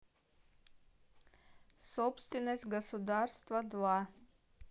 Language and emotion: Russian, neutral